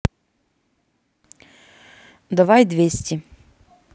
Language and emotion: Russian, neutral